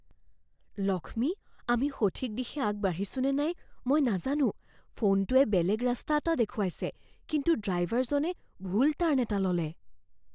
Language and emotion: Assamese, fearful